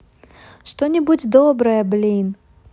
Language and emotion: Russian, positive